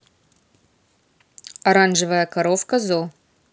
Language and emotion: Russian, neutral